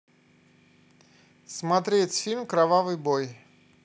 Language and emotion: Russian, neutral